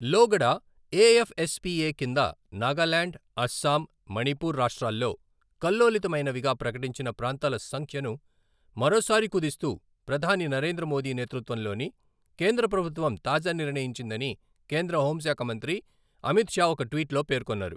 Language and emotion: Telugu, neutral